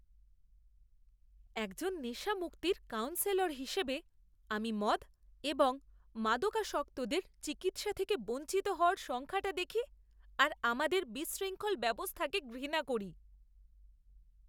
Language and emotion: Bengali, disgusted